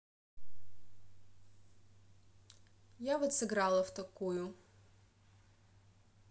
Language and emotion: Russian, neutral